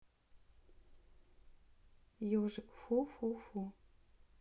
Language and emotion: Russian, neutral